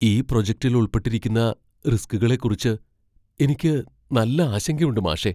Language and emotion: Malayalam, fearful